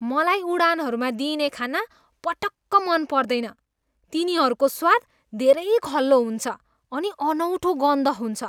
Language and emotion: Nepali, disgusted